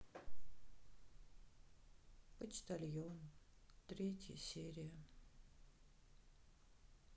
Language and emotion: Russian, sad